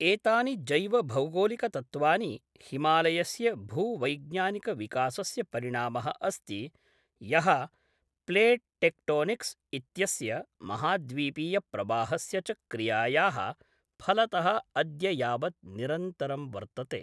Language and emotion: Sanskrit, neutral